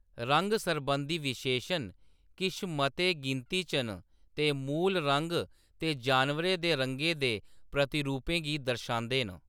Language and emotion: Dogri, neutral